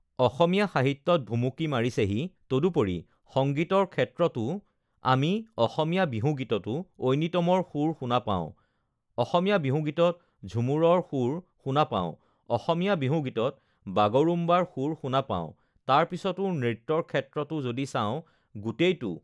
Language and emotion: Assamese, neutral